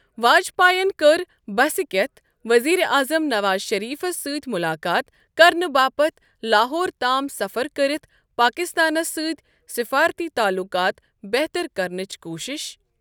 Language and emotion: Kashmiri, neutral